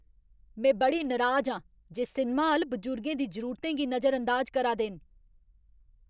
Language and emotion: Dogri, angry